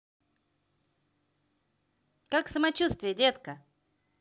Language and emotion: Russian, positive